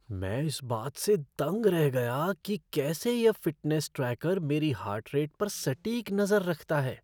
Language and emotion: Hindi, surprised